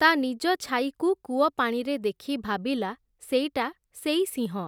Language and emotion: Odia, neutral